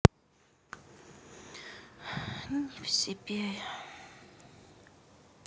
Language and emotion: Russian, sad